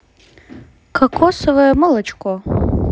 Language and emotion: Russian, neutral